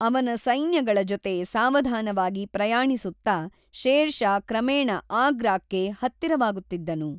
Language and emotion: Kannada, neutral